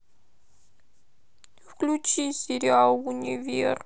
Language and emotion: Russian, sad